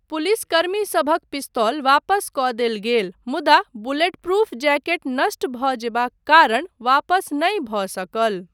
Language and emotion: Maithili, neutral